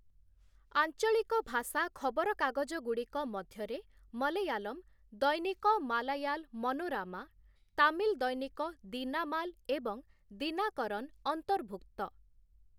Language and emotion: Odia, neutral